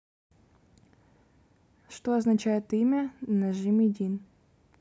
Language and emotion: Russian, neutral